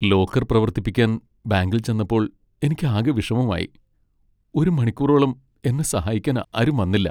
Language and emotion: Malayalam, sad